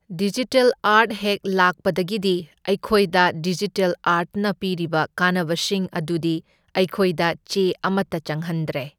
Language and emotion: Manipuri, neutral